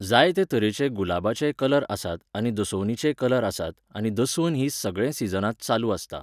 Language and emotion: Goan Konkani, neutral